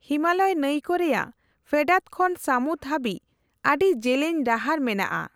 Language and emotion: Santali, neutral